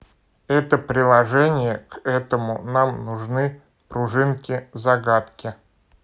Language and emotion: Russian, neutral